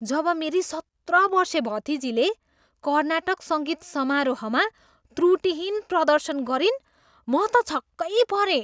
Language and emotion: Nepali, surprised